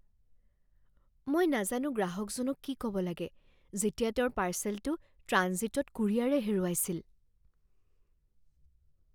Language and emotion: Assamese, fearful